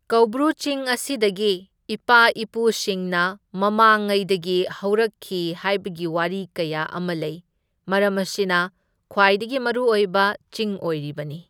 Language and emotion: Manipuri, neutral